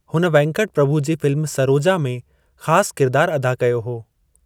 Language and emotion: Sindhi, neutral